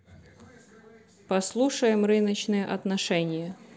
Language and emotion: Russian, neutral